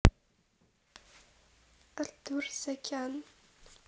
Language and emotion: Russian, neutral